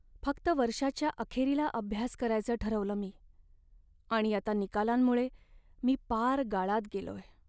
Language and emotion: Marathi, sad